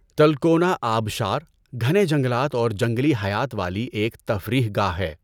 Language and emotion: Urdu, neutral